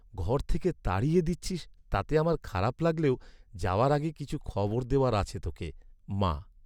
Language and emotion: Bengali, sad